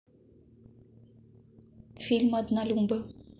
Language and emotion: Russian, neutral